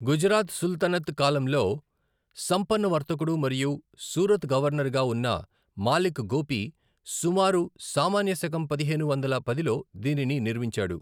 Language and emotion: Telugu, neutral